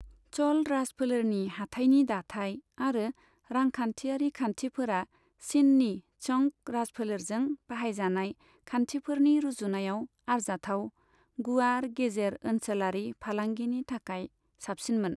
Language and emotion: Bodo, neutral